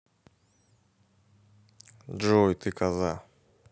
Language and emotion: Russian, neutral